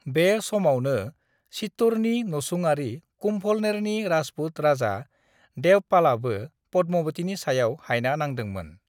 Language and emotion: Bodo, neutral